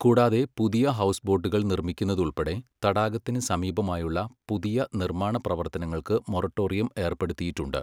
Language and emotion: Malayalam, neutral